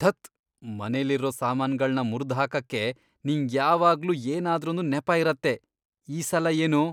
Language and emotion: Kannada, disgusted